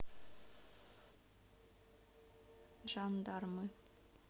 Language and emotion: Russian, neutral